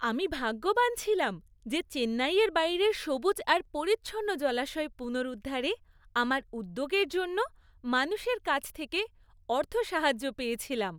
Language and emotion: Bengali, happy